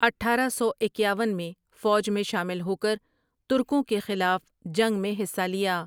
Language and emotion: Urdu, neutral